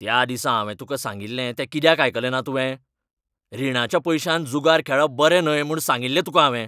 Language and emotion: Goan Konkani, angry